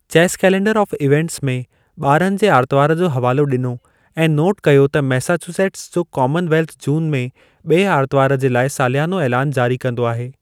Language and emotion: Sindhi, neutral